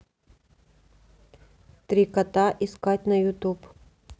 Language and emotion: Russian, neutral